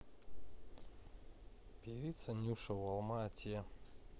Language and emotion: Russian, neutral